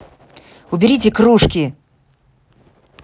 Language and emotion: Russian, angry